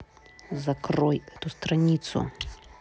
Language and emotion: Russian, angry